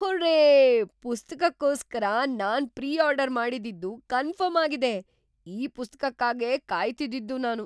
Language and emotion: Kannada, surprised